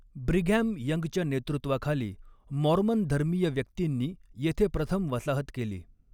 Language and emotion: Marathi, neutral